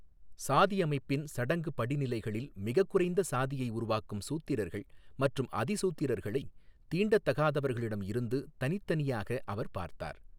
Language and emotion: Tamil, neutral